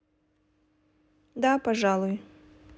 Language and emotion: Russian, neutral